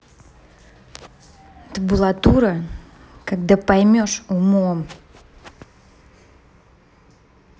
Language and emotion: Russian, angry